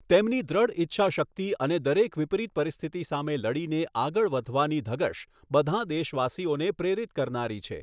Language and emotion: Gujarati, neutral